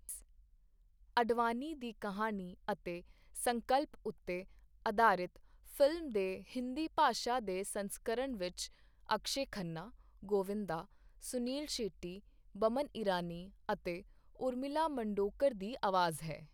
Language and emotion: Punjabi, neutral